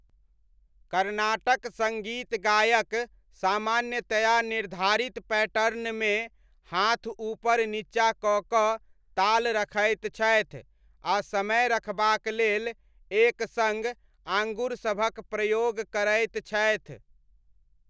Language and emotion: Maithili, neutral